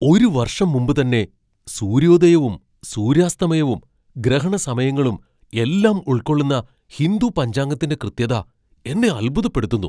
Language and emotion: Malayalam, surprised